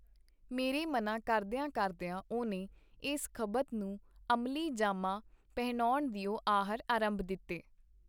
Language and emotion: Punjabi, neutral